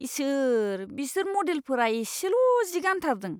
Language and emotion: Bodo, disgusted